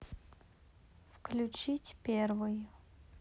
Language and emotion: Russian, neutral